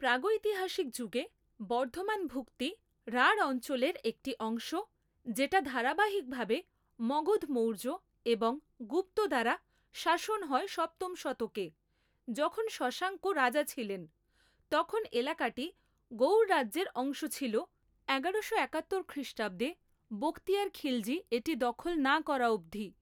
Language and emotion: Bengali, neutral